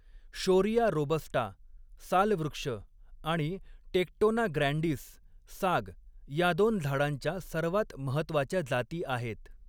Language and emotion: Marathi, neutral